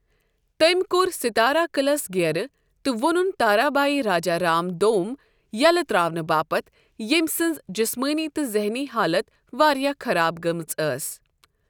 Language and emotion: Kashmiri, neutral